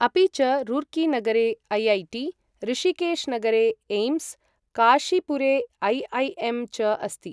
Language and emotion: Sanskrit, neutral